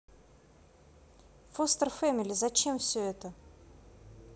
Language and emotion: Russian, neutral